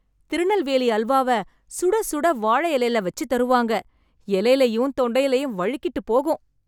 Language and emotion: Tamil, happy